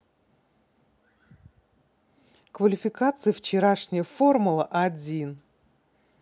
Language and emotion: Russian, positive